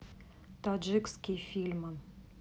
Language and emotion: Russian, neutral